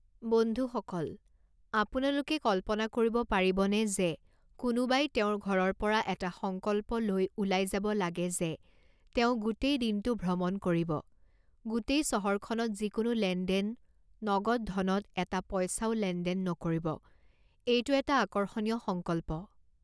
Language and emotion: Assamese, neutral